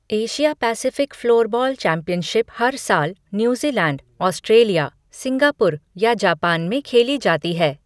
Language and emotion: Hindi, neutral